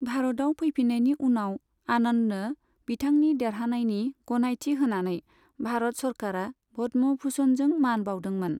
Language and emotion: Bodo, neutral